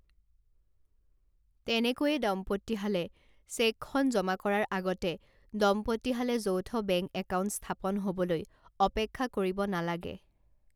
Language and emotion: Assamese, neutral